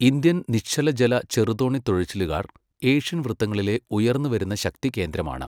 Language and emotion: Malayalam, neutral